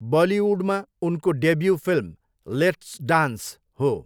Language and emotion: Nepali, neutral